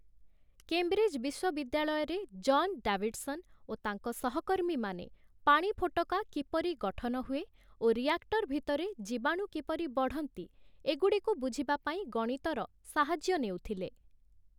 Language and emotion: Odia, neutral